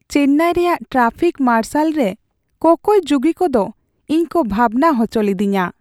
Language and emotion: Santali, sad